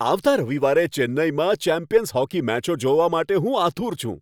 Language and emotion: Gujarati, happy